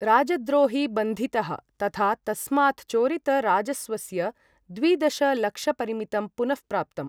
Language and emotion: Sanskrit, neutral